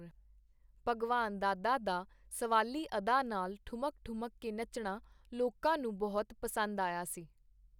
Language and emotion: Punjabi, neutral